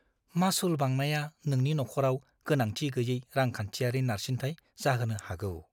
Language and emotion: Bodo, fearful